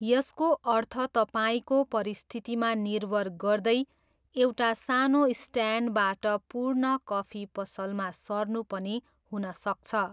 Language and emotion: Nepali, neutral